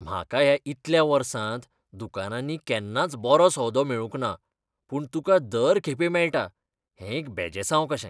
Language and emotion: Goan Konkani, disgusted